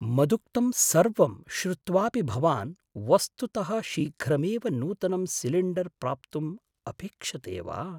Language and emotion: Sanskrit, surprised